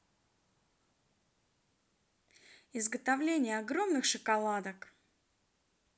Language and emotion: Russian, positive